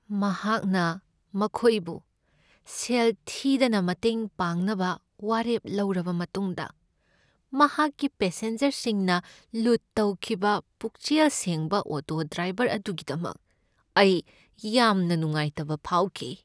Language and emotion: Manipuri, sad